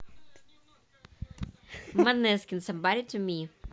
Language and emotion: Russian, neutral